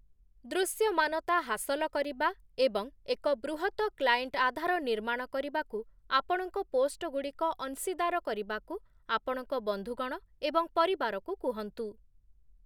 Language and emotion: Odia, neutral